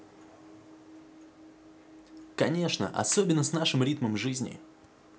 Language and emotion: Russian, positive